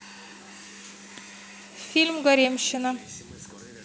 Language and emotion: Russian, neutral